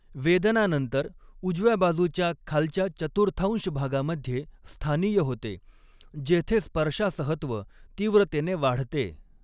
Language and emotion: Marathi, neutral